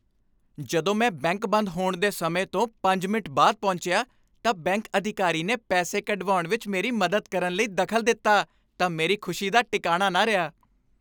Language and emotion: Punjabi, happy